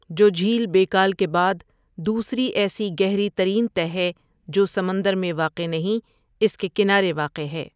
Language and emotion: Urdu, neutral